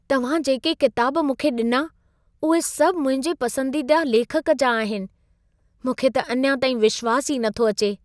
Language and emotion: Sindhi, surprised